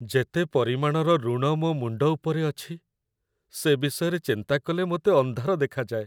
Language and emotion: Odia, sad